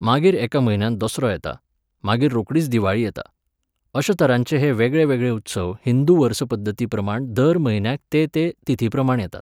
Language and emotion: Goan Konkani, neutral